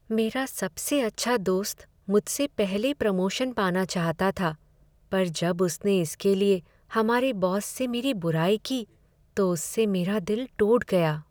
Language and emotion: Hindi, sad